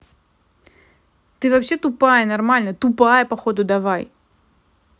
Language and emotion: Russian, angry